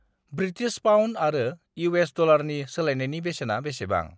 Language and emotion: Bodo, neutral